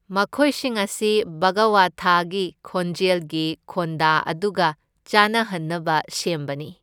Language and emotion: Manipuri, neutral